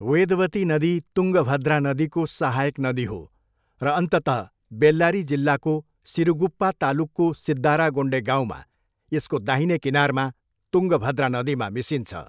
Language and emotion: Nepali, neutral